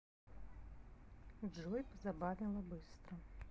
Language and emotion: Russian, neutral